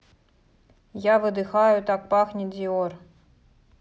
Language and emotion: Russian, neutral